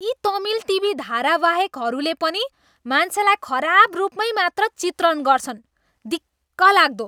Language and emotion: Nepali, disgusted